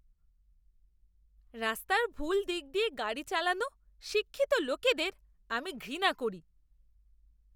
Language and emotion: Bengali, disgusted